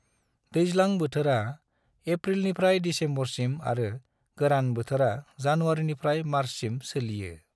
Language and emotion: Bodo, neutral